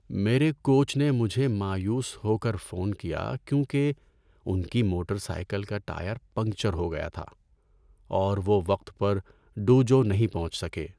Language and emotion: Urdu, sad